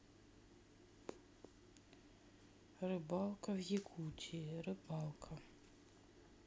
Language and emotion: Russian, sad